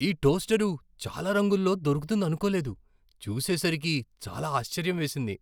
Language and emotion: Telugu, surprised